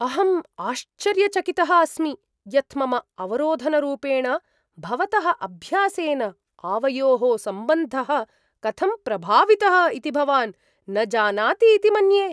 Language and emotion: Sanskrit, surprised